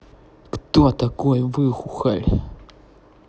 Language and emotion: Russian, neutral